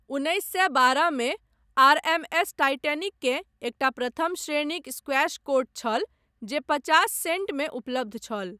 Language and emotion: Maithili, neutral